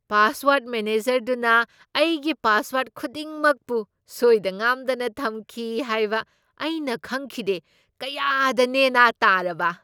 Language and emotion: Manipuri, surprised